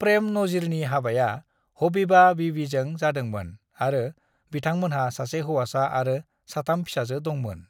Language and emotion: Bodo, neutral